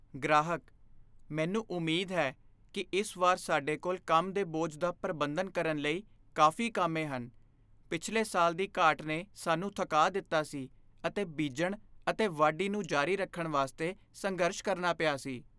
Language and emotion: Punjabi, fearful